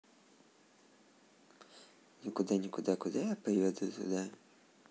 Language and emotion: Russian, neutral